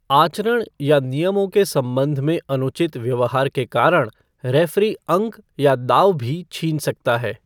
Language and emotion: Hindi, neutral